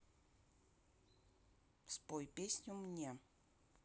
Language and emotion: Russian, neutral